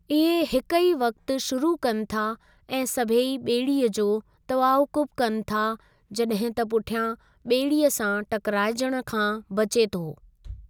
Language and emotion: Sindhi, neutral